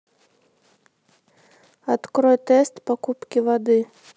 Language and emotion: Russian, neutral